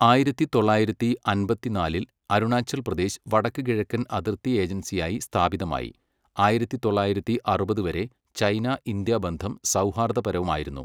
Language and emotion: Malayalam, neutral